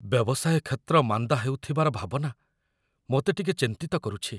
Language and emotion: Odia, fearful